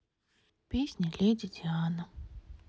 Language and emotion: Russian, sad